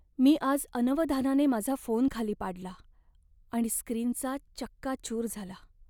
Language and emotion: Marathi, sad